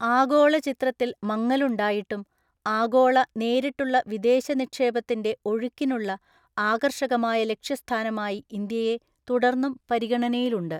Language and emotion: Malayalam, neutral